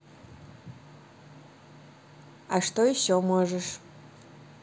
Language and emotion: Russian, neutral